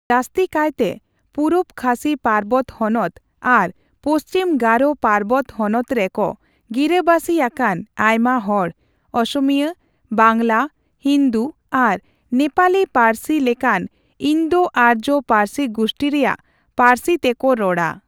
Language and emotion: Santali, neutral